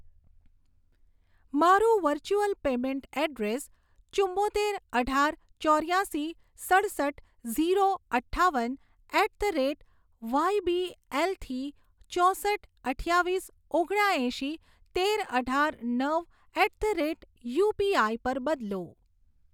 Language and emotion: Gujarati, neutral